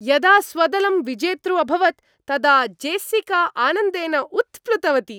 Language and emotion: Sanskrit, happy